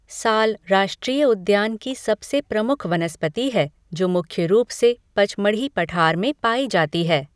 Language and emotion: Hindi, neutral